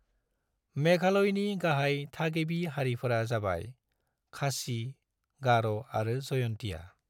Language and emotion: Bodo, neutral